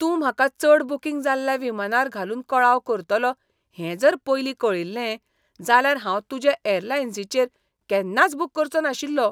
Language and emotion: Goan Konkani, disgusted